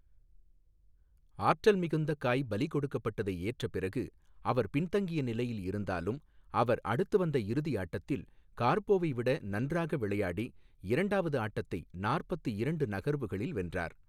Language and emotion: Tamil, neutral